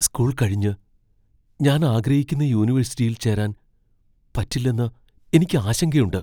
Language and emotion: Malayalam, fearful